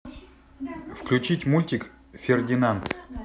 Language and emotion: Russian, neutral